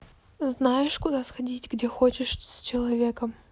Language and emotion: Russian, neutral